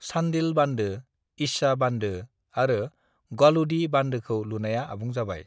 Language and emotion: Bodo, neutral